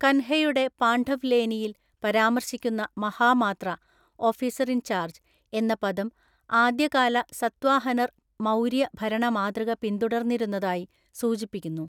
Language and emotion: Malayalam, neutral